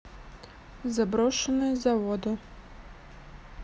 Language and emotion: Russian, neutral